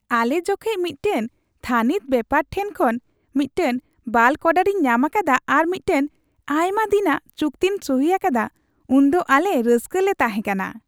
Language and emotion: Santali, happy